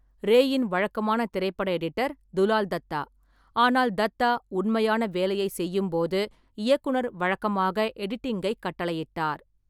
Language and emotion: Tamil, neutral